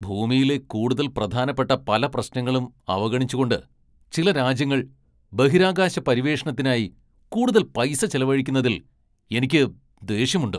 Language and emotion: Malayalam, angry